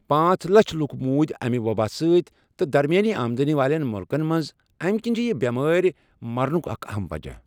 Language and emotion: Kashmiri, neutral